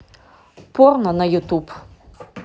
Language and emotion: Russian, neutral